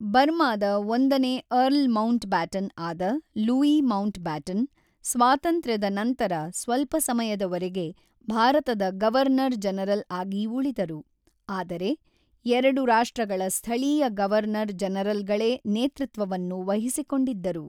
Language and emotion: Kannada, neutral